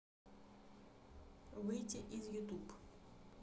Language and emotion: Russian, neutral